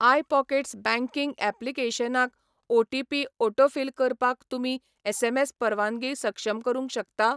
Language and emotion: Goan Konkani, neutral